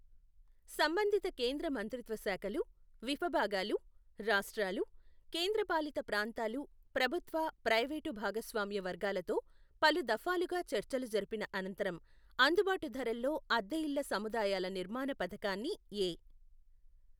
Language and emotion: Telugu, neutral